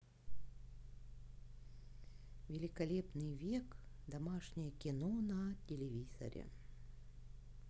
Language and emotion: Russian, positive